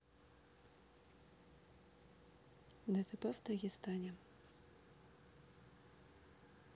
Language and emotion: Russian, neutral